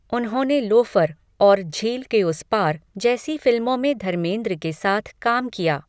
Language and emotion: Hindi, neutral